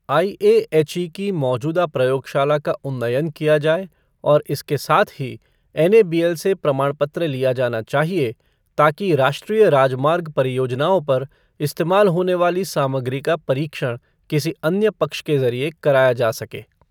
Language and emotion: Hindi, neutral